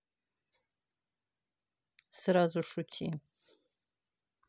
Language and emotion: Russian, neutral